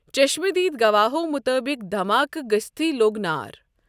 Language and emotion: Kashmiri, neutral